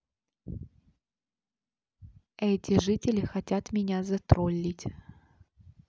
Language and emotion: Russian, neutral